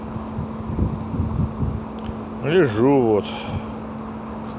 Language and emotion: Russian, sad